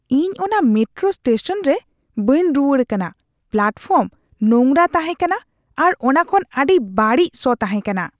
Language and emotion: Santali, disgusted